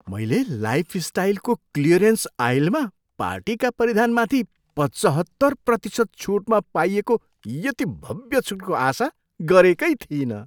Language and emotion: Nepali, surprised